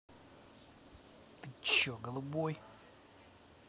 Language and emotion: Russian, angry